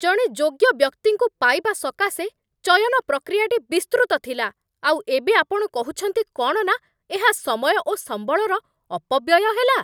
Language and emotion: Odia, angry